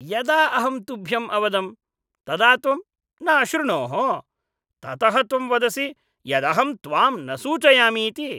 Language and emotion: Sanskrit, disgusted